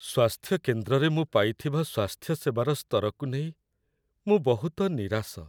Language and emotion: Odia, sad